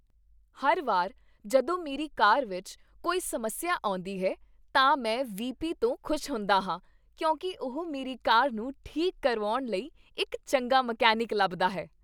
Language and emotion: Punjabi, happy